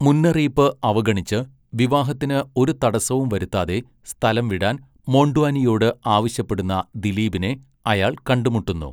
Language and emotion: Malayalam, neutral